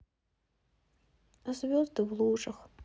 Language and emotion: Russian, sad